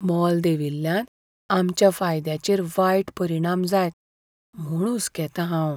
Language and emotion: Goan Konkani, fearful